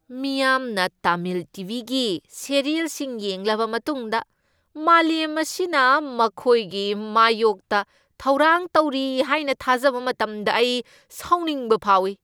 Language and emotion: Manipuri, angry